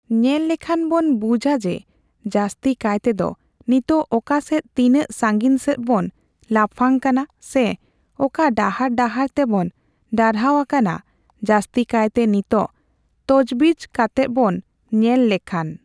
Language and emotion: Santali, neutral